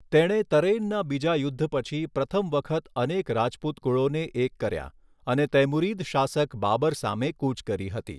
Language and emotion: Gujarati, neutral